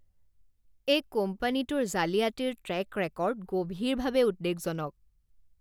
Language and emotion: Assamese, disgusted